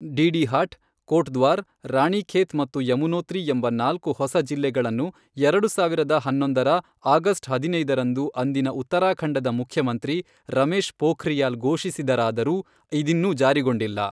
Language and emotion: Kannada, neutral